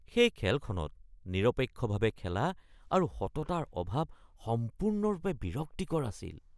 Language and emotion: Assamese, disgusted